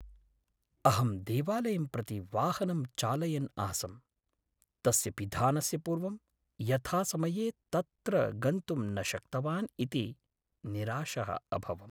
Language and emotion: Sanskrit, sad